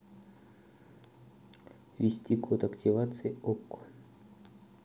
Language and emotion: Russian, neutral